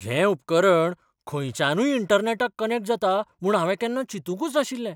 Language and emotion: Goan Konkani, surprised